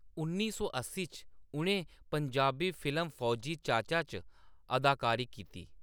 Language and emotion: Dogri, neutral